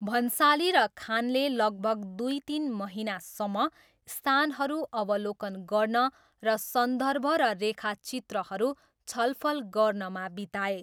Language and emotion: Nepali, neutral